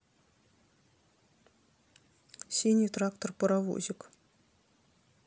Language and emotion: Russian, neutral